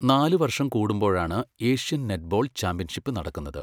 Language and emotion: Malayalam, neutral